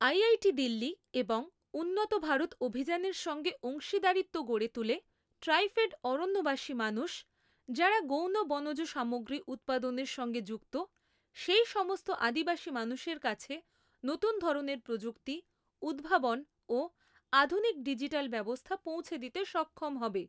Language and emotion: Bengali, neutral